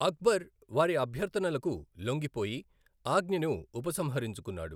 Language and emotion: Telugu, neutral